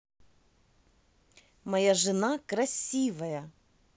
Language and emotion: Russian, positive